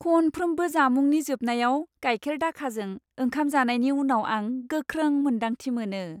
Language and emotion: Bodo, happy